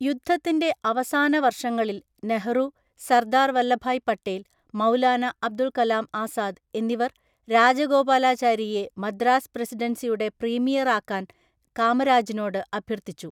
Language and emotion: Malayalam, neutral